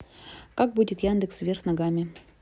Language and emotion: Russian, neutral